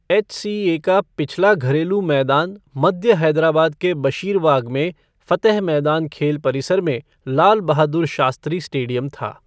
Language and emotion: Hindi, neutral